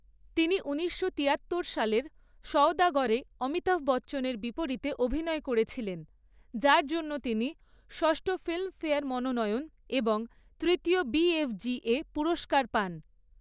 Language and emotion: Bengali, neutral